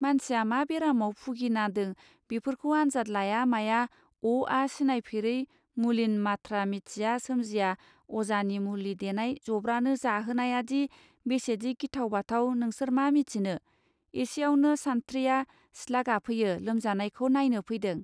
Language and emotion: Bodo, neutral